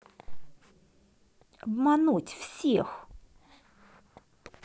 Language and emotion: Russian, angry